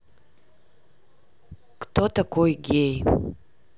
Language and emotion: Russian, neutral